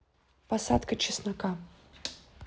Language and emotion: Russian, neutral